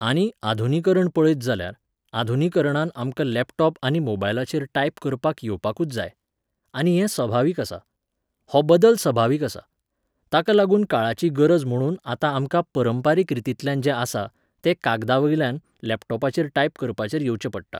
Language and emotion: Goan Konkani, neutral